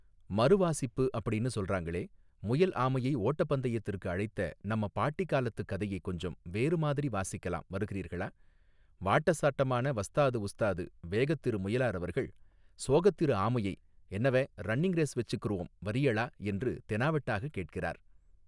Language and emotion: Tamil, neutral